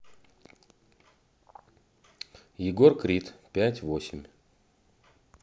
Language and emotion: Russian, neutral